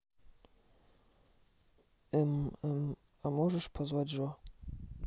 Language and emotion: Russian, neutral